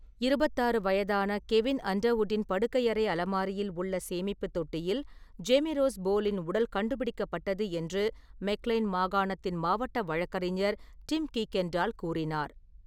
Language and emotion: Tamil, neutral